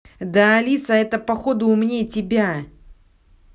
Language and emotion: Russian, angry